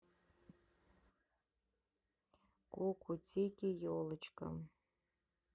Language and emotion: Russian, neutral